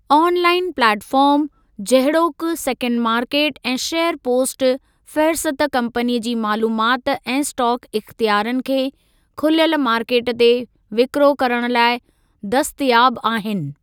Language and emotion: Sindhi, neutral